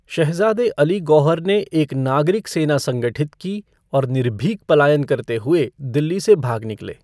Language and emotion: Hindi, neutral